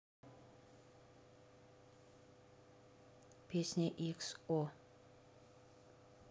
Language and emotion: Russian, neutral